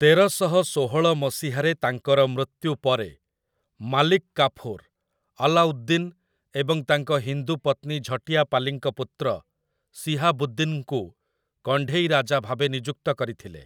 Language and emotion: Odia, neutral